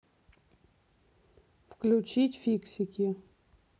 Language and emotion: Russian, neutral